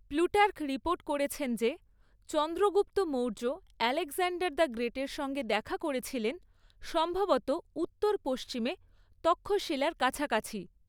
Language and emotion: Bengali, neutral